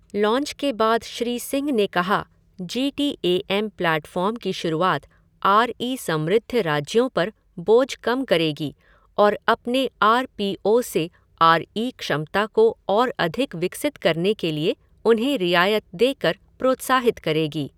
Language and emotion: Hindi, neutral